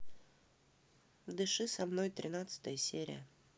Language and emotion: Russian, neutral